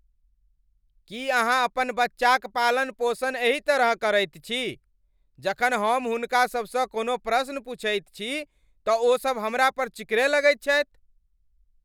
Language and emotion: Maithili, angry